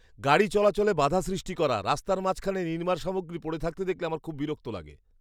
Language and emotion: Bengali, disgusted